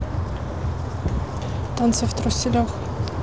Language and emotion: Russian, neutral